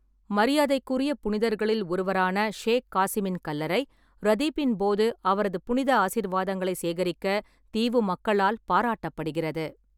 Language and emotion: Tamil, neutral